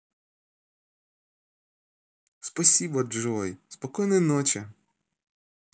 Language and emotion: Russian, positive